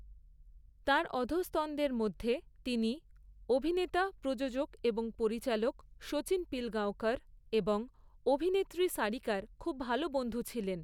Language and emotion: Bengali, neutral